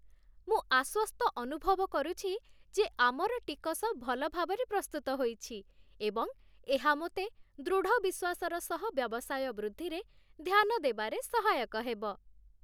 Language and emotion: Odia, happy